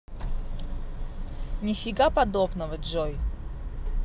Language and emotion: Russian, angry